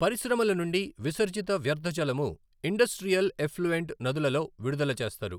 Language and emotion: Telugu, neutral